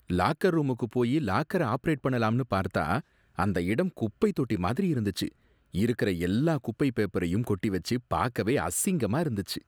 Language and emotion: Tamil, disgusted